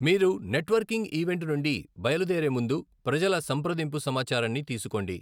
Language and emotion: Telugu, neutral